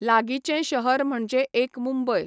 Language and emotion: Goan Konkani, neutral